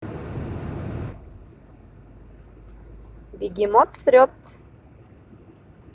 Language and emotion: Russian, positive